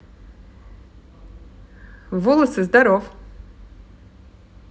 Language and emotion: Russian, positive